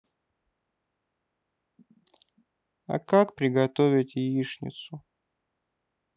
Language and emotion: Russian, sad